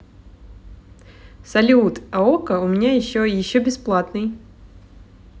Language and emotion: Russian, positive